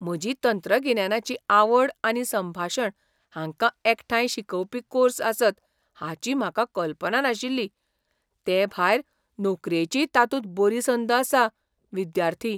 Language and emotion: Goan Konkani, surprised